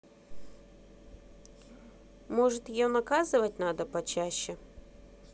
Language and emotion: Russian, neutral